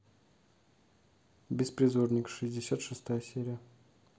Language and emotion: Russian, neutral